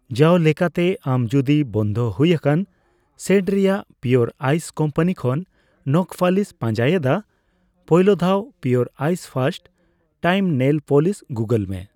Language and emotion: Santali, neutral